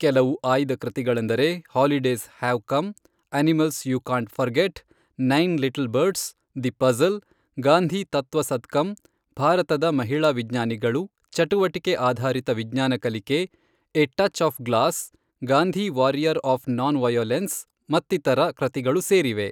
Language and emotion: Kannada, neutral